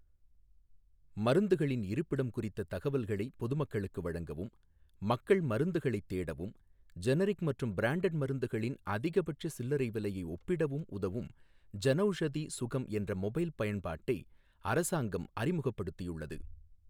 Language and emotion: Tamil, neutral